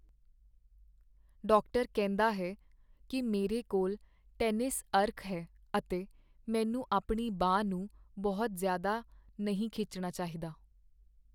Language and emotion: Punjabi, sad